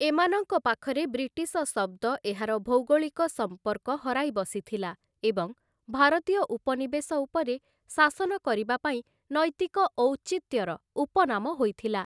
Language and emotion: Odia, neutral